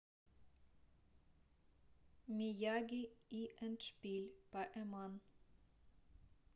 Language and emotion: Russian, neutral